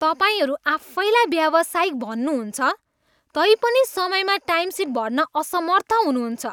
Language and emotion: Nepali, disgusted